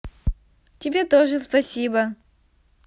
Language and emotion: Russian, positive